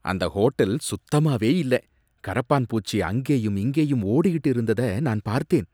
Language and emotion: Tamil, disgusted